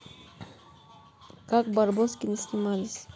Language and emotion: Russian, neutral